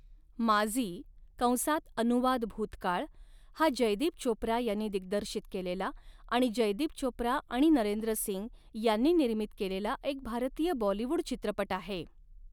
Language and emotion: Marathi, neutral